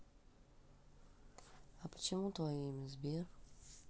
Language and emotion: Russian, neutral